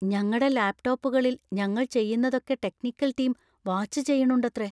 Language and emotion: Malayalam, fearful